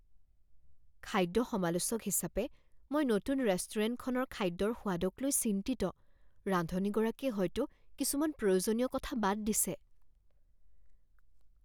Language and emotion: Assamese, fearful